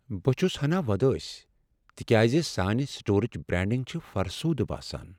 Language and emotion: Kashmiri, sad